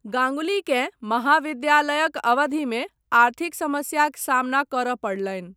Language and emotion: Maithili, neutral